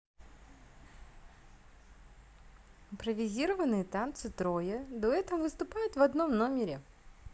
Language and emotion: Russian, positive